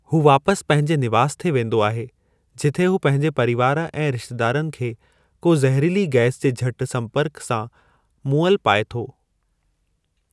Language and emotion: Sindhi, neutral